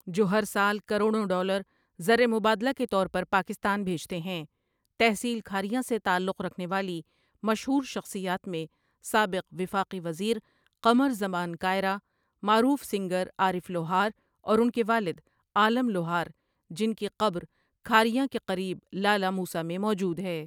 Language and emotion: Urdu, neutral